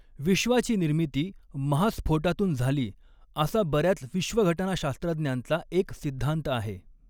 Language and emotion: Marathi, neutral